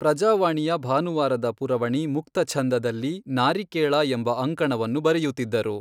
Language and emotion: Kannada, neutral